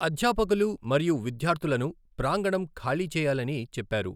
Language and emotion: Telugu, neutral